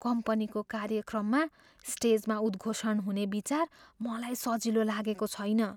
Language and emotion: Nepali, fearful